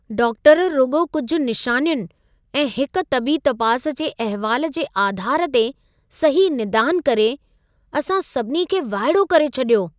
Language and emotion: Sindhi, surprised